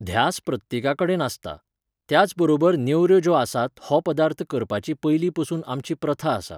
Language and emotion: Goan Konkani, neutral